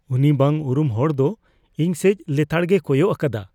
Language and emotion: Santali, fearful